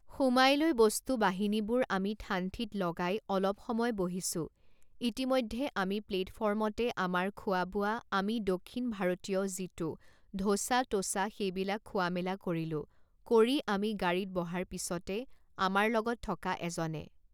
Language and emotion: Assamese, neutral